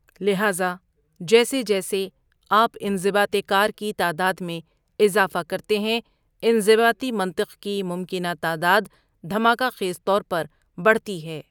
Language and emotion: Urdu, neutral